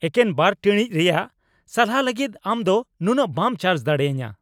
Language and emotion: Santali, angry